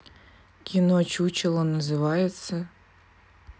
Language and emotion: Russian, neutral